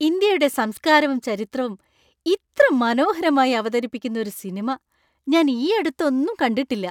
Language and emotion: Malayalam, happy